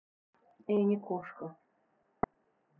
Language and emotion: Russian, neutral